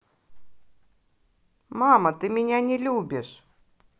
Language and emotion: Russian, positive